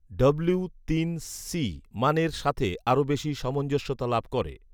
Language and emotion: Bengali, neutral